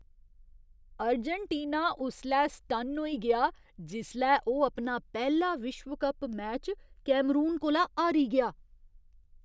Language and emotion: Dogri, surprised